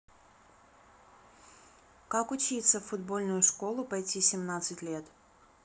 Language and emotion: Russian, neutral